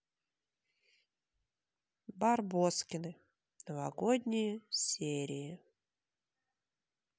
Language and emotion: Russian, neutral